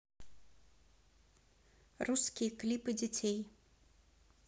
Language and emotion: Russian, neutral